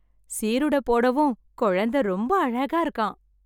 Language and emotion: Tamil, happy